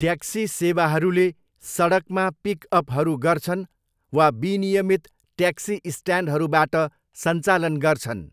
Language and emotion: Nepali, neutral